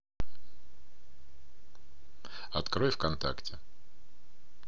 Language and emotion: Russian, neutral